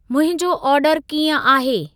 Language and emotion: Sindhi, neutral